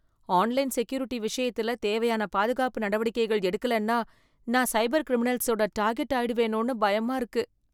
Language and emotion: Tamil, fearful